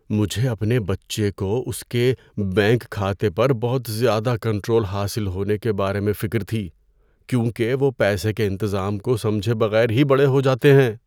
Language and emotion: Urdu, fearful